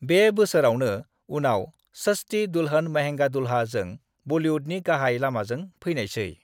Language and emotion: Bodo, neutral